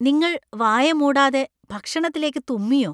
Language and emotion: Malayalam, disgusted